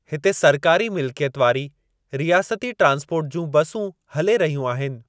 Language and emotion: Sindhi, neutral